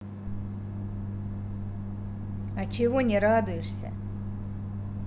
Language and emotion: Russian, neutral